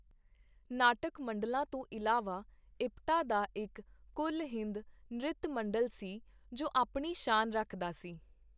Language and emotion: Punjabi, neutral